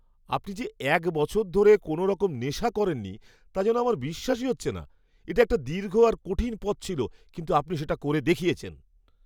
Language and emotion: Bengali, surprised